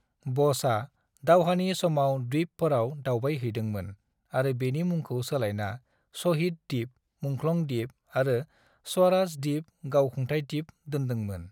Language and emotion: Bodo, neutral